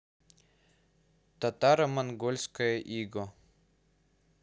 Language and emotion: Russian, neutral